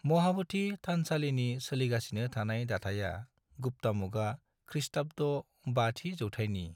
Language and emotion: Bodo, neutral